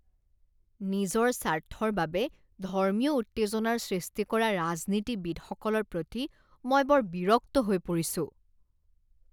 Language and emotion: Assamese, disgusted